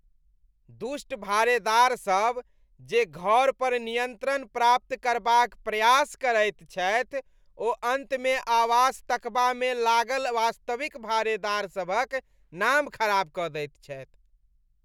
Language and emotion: Maithili, disgusted